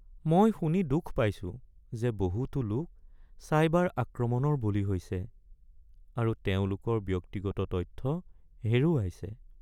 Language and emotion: Assamese, sad